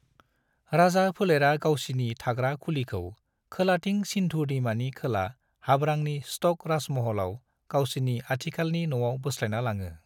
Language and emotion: Bodo, neutral